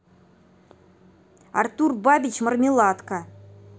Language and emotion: Russian, neutral